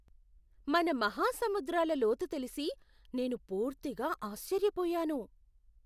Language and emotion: Telugu, surprised